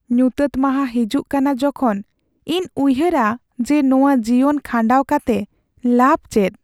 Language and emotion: Santali, sad